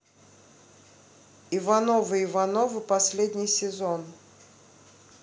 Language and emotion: Russian, neutral